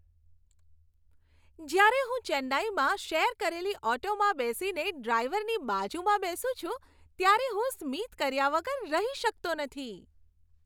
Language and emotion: Gujarati, happy